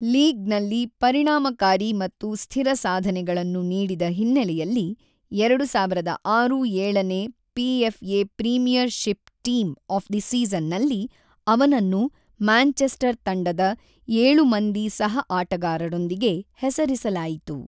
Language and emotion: Kannada, neutral